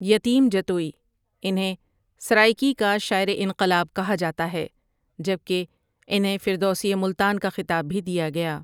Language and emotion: Urdu, neutral